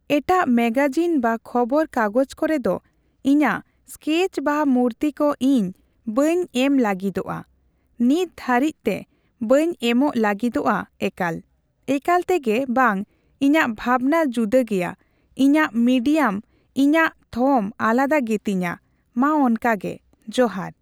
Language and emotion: Santali, neutral